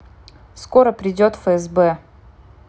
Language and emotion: Russian, neutral